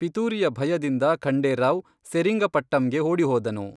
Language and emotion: Kannada, neutral